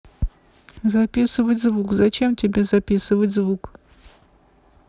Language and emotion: Russian, neutral